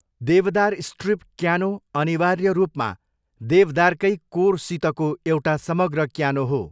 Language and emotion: Nepali, neutral